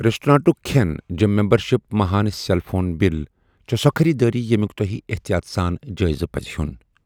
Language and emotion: Kashmiri, neutral